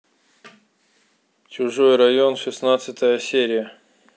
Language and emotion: Russian, neutral